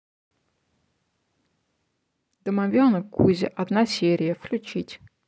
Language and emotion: Russian, neutral